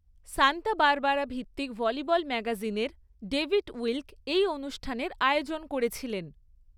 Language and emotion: Bengali, neutral